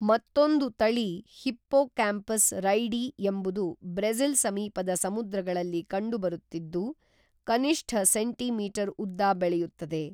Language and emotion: Kannada, neutral